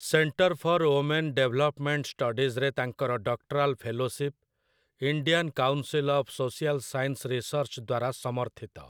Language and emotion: Odia, neutral